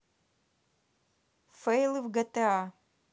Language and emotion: Russian, neutral